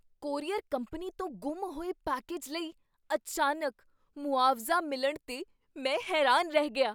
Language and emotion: Punjabi, surprised